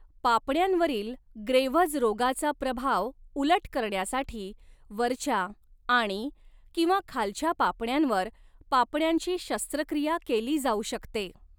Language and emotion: Marathi, neutral